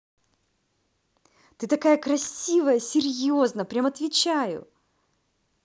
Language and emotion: Russian, positive